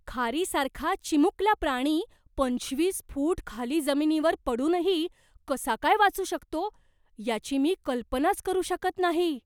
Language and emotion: Marathi, surprised